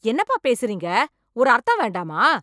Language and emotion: Tamil, angry